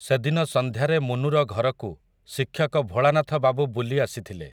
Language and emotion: Odia, neutral